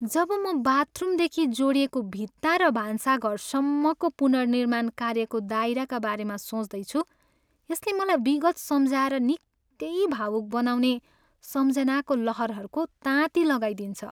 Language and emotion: Nepali, sad